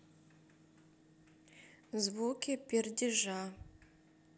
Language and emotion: Russian, neutral